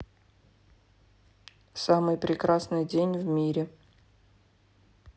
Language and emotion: Russian, neutral